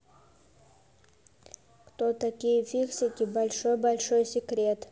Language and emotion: Russian, neutral